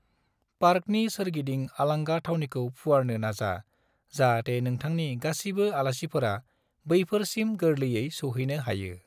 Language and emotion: Bodo, neutral